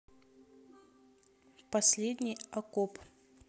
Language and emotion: Russian, neutral